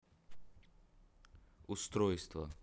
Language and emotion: Russian, neutral